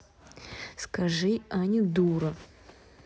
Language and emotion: Russian, neutral